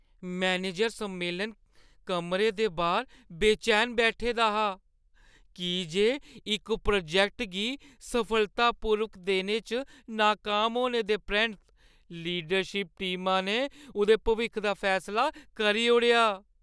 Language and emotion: Dogri, fearful